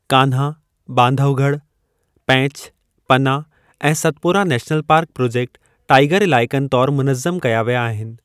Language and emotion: Sindhi, neutral